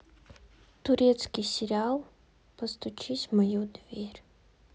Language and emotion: Russian, sad